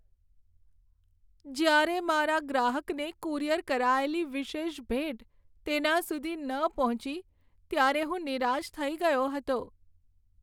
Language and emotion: Gujarati, sad